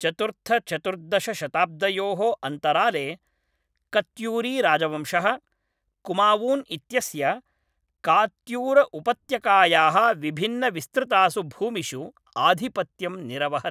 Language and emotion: Sanskrit, neutral